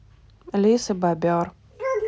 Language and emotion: Russian, neutral